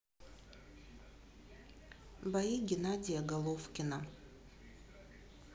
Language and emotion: Russian, neutral